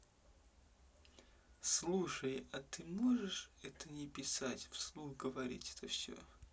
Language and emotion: Russian, neutral